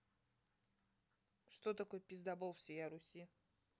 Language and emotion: Russian, neutral